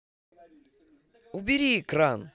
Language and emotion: Russian, angry